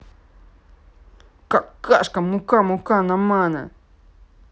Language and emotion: Russian, angry